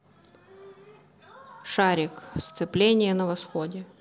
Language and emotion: Russian, neutral